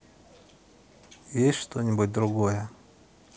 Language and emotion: Russian, neutral